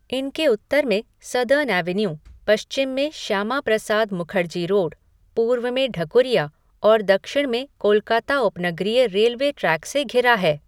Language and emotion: Hindi, neutral